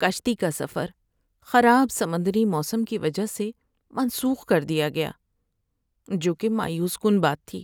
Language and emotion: Urdu, sad